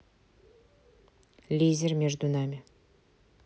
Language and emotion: Russian, neutral